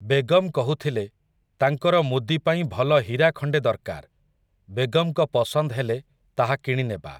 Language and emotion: Odia, neutral